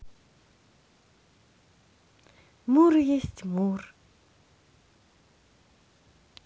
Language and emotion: Russian, positive